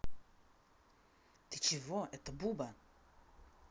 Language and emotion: Russian, angry